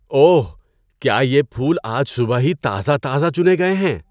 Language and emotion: Urdu, surprised